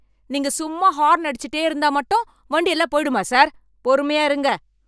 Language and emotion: Tamil, angry